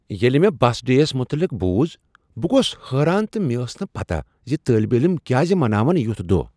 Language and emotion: Kashmiri, surprised